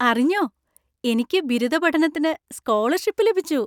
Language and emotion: Malayalam, happy